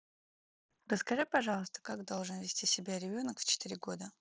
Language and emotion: Russian, neutral